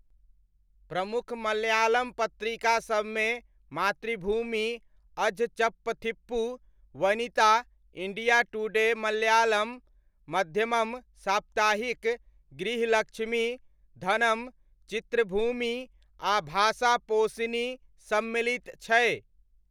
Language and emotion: Maithili, neutral